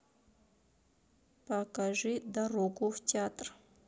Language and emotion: Russian, neutral